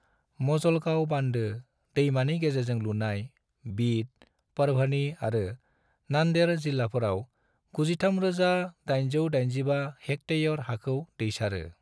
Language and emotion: Bodo, neutral